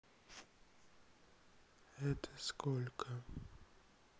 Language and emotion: Russian, sad